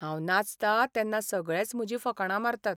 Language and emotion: Goan Konkani, sad